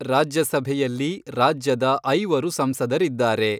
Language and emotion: Kannada, neutral